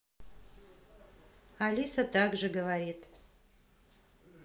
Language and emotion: Russian, neutral